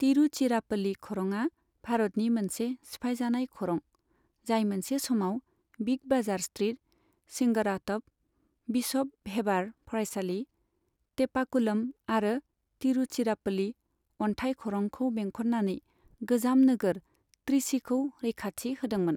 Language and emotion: Bodo, neutral